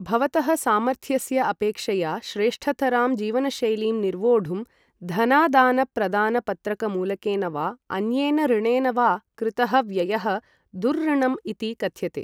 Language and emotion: Sanskrit, neutral